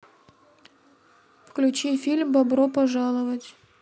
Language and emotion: Russian, neutral